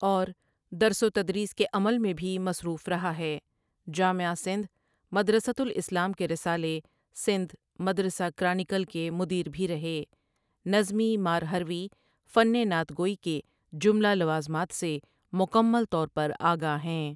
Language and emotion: Urdu, neutral